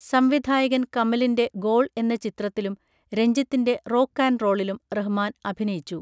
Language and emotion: Malayalam, neutral